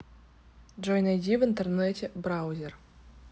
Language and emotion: Russian, neutral